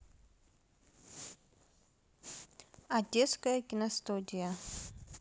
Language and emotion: Russian, neutral